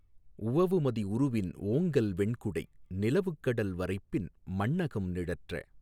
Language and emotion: Tamil, neutral